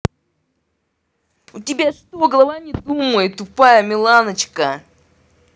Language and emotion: Russian, angry